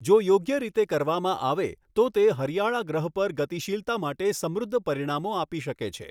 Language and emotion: Gujarati, neutral